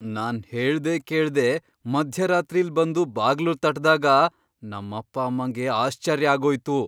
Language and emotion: Kannada, surprised